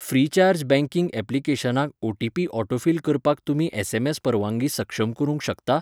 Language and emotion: Goan Konkani, neutral